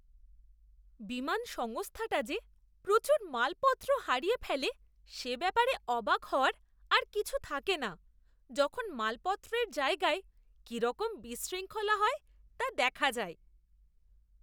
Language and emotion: Bengali, disgusted